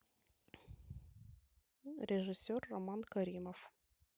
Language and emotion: Russian, neutral